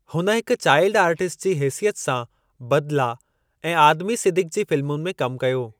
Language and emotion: Sindhi, neutral